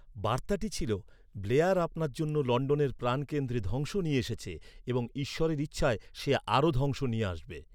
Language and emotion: Bengali, neutral